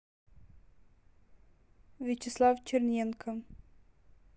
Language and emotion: Russian, neutral